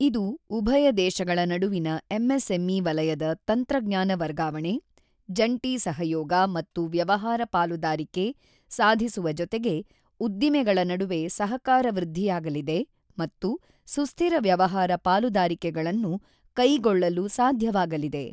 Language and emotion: Kannada, neutral